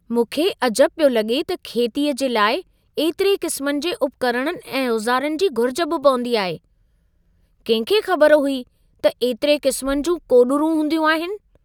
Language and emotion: Sindhi, surprised